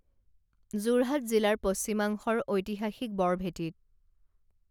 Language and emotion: Assamese, neutral